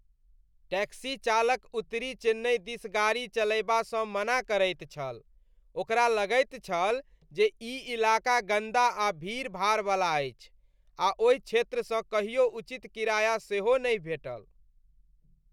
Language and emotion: Maithili, disgusted